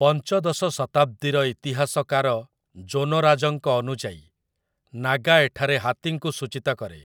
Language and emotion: Odia, neutral